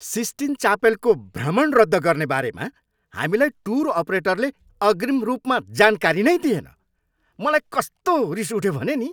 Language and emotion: Nepali, angry